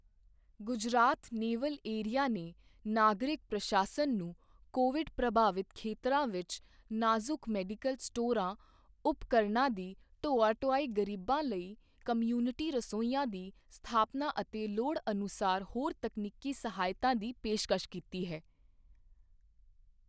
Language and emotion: Punjabi, neutral